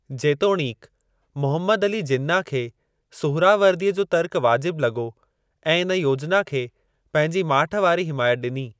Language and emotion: Sindhi, neutral